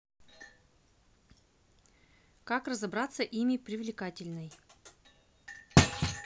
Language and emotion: Russian, neutral